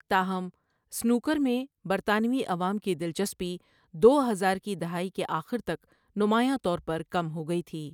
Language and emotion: Urdu, neutral